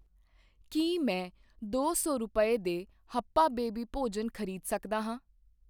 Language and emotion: Punjabi, neutral